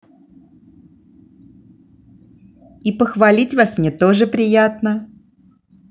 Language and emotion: Russian, positive